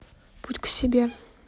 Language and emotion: Russian, neutral